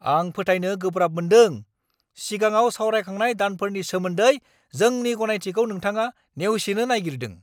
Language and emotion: Bodo, angry